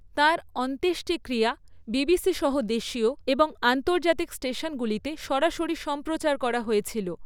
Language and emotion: Bengali, neutral